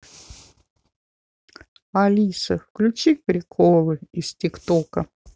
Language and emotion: Russian, sad